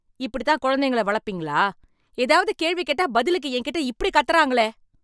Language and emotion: Tamil, angry